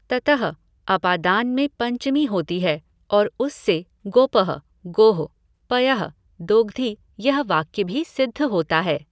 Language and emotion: Hindi, neutral